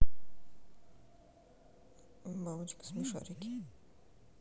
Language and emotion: Russian, neutral